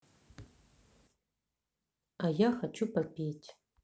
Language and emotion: Russian, neutral